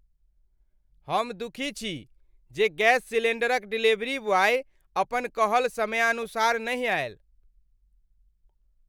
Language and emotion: Maithili, angry